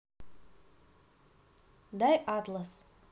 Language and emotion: Russian, neutral